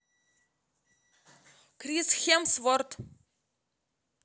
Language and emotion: Russian, neutral